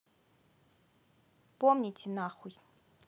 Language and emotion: Russian, neutral